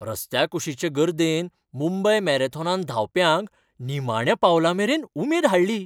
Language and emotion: Goan Konkani, happy